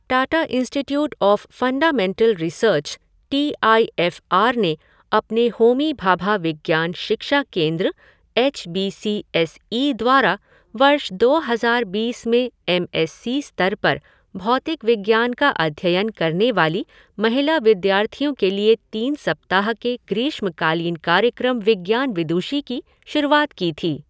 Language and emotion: Hindi, neutral